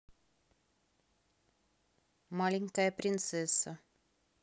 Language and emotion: Russian, neutral